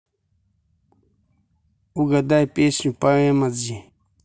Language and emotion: Russian, neutral